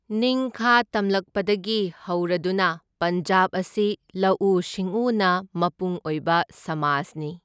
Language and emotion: Manipuri, neutral